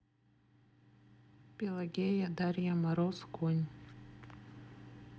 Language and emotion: Russian, neutral